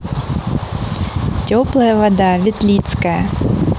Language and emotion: Russian, positive